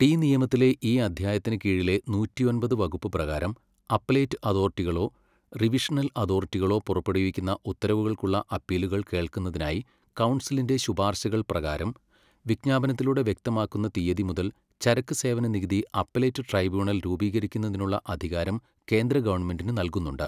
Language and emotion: Malayalam, neutral